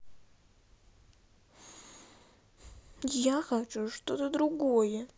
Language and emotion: Russian, sad